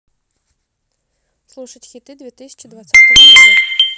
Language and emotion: Russian, neutral